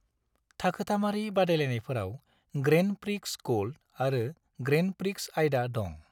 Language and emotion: Bodo, neutral